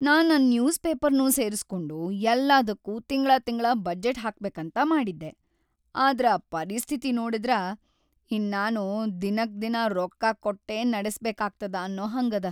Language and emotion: Kannada, sad